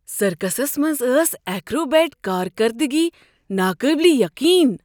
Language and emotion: Kashmiri, surprised